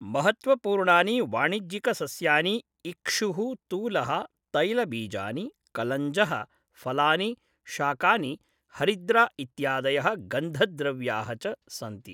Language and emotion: Sanskrit, neutral